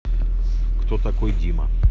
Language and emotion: Russian, neutral